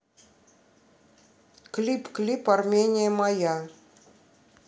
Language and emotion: Russian, neutral